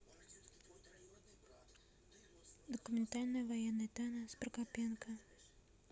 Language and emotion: Russian, neutral